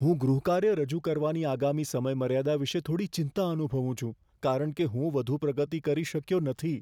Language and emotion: Gujarati, fearful